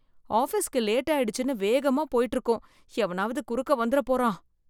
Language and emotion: Tamil, fearful